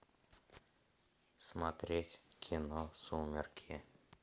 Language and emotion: Russian, neutral